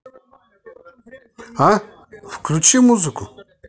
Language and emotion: Russian, neutral